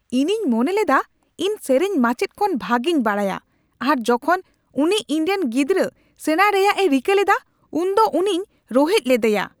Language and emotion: Santali, angry